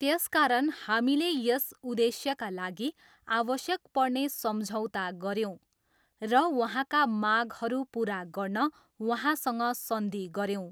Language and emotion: Nepali, neutral